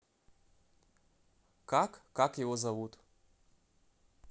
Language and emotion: Russian, neutral